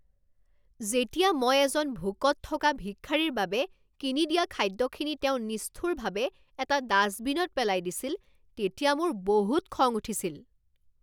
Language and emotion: Assamese, angry